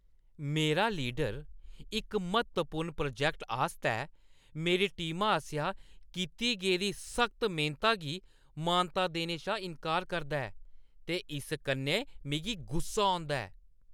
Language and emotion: Dogri, angry